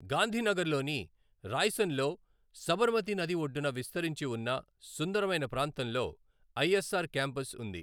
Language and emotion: Telugu, neutral